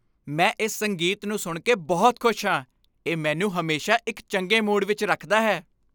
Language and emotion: Punjabi, happy